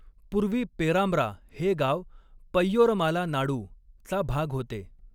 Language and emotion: Marathi, neutral